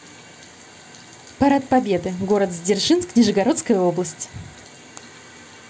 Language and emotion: Russian, positive